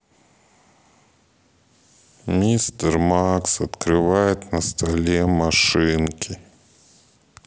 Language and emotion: Russian, sad